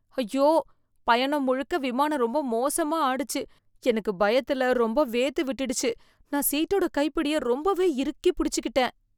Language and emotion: Tamil, fearful